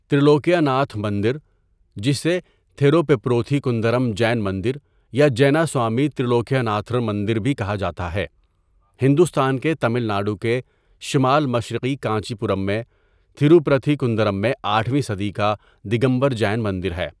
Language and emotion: Urdu, neutral